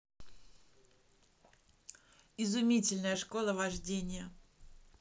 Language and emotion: Russian, positive